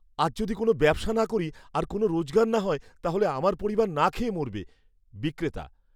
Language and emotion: Bengali, fearful